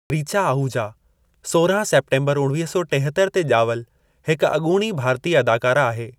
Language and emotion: Sindhi, neutral